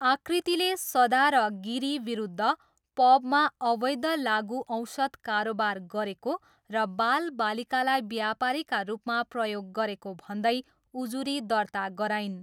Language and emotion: Nepali, neutral